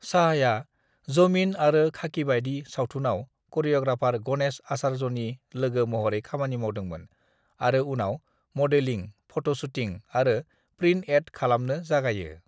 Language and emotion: Bodo, neutral